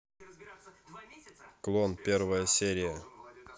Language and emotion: Russian, neutral